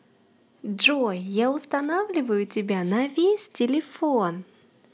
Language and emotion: Russian, positive